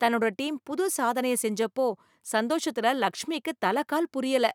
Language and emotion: Tamil, happy